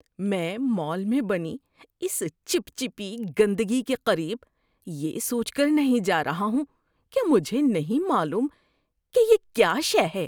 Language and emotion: Urdu, disgusted